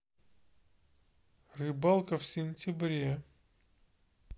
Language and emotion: Russian, neutral